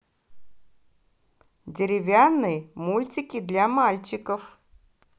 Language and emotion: Russian, positive